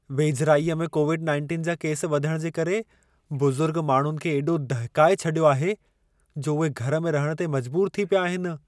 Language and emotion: Sindhi, fearful